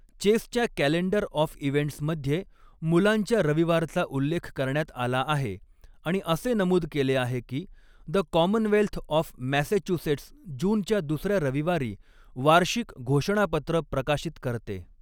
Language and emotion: Marathi, neutral